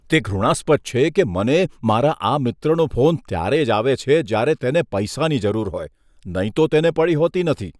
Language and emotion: Gujarati, disgusted